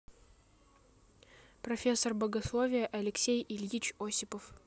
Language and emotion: Russian, neutral